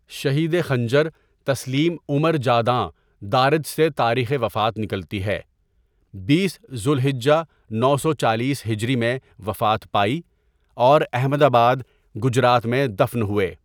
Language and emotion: Urdu, neutral